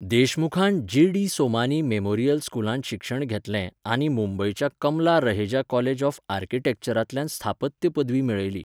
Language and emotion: Goan Konkani, neutral